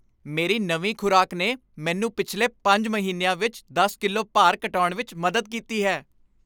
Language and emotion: Punjabi, happy